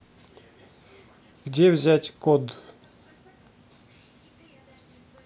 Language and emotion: Russian, neutral